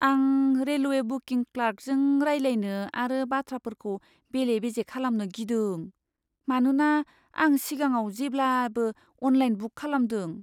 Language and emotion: Bodo, fearful